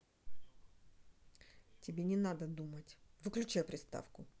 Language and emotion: Russian, angry